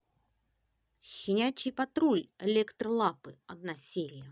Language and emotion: Russian, positive